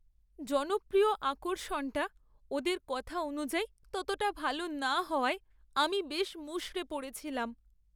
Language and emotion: Bengali, sad